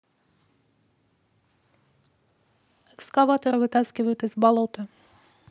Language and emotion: Russian, neutral